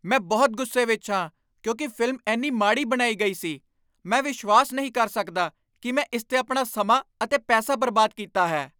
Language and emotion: Punjabi, angry